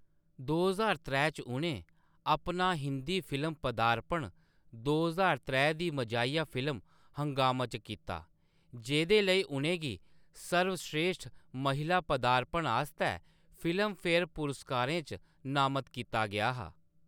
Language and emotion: Dogri, neutral